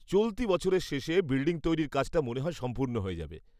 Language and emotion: Bengali, happy